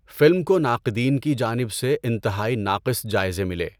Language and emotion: Urdu, neutral